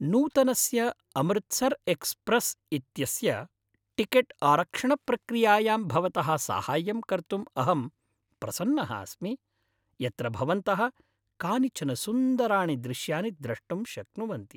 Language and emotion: Sanskrit, happy